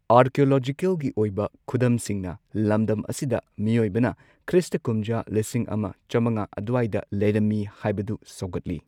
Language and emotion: Manipuri, neutral